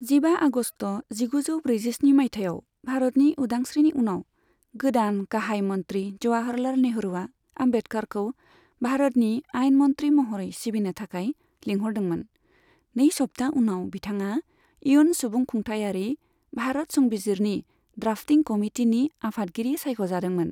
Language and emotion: Bodo, neutral